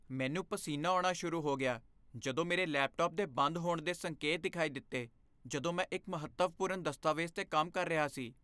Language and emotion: Punjabi, fearful